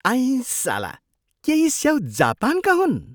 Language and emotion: Nepali, surprised